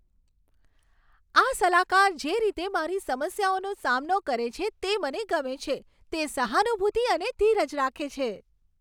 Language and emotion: Gujarati, happy